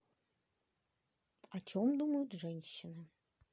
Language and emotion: Russian, neutral